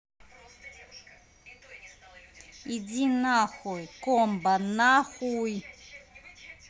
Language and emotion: Russian, angry